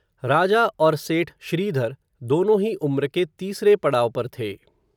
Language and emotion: Hindi, neutral